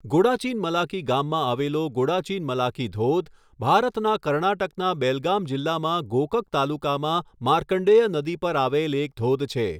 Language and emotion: Gujarati, neutral